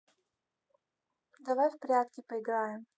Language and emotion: Russian, neutral